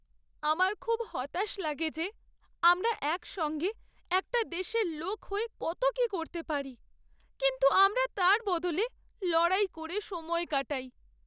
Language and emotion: Bengali, sad